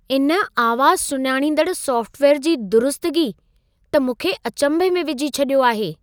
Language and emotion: Sindhi, surprised